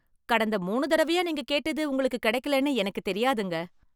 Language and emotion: Tamil, surprised